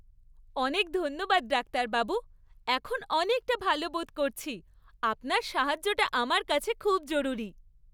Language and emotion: Bengali, happy